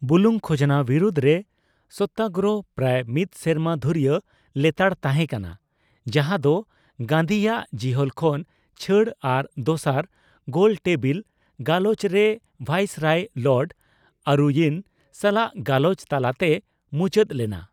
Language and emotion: Santali, neutral